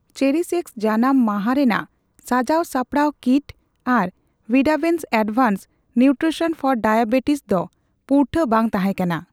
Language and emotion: Santali, neutral